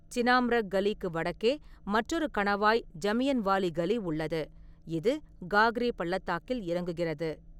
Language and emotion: Tamil, neutral